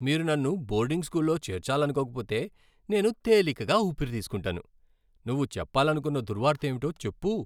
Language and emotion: Telugu, happy